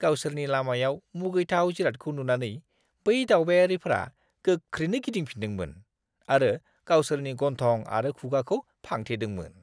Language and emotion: Bodo, disgusted